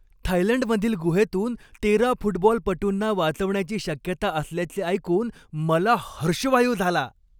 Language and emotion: Marathi, happy